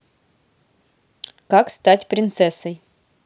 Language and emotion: Russian, neutral